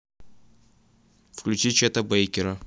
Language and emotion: Russian, neutral